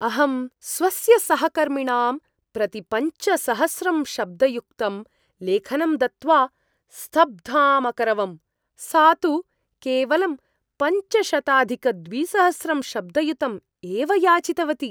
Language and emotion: Sanskrit, surprised